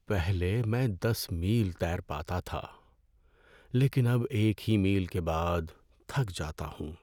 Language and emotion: Urdu, sad